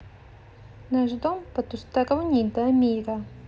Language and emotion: Russian, neutral